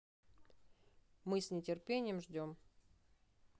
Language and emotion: Russian, neutral